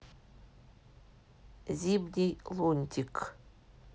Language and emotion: Russian, neutral